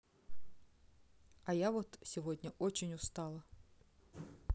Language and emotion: Russian, neutral